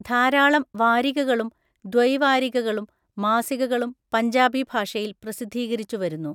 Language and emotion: Malayalam, neutral